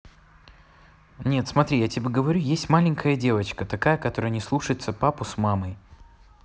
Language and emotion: Russian, neutral